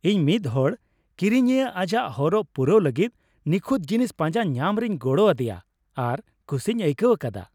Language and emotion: Santali, happy